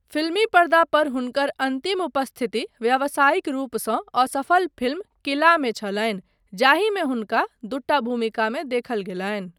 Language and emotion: Maithili, neutral